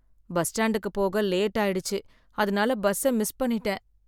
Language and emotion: Tamil, sad